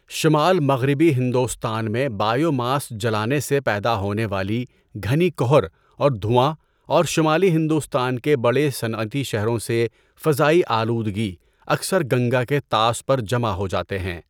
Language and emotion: Urdu, neutral